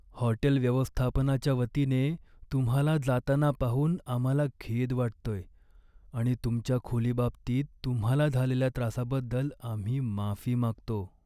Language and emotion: Marathi, sad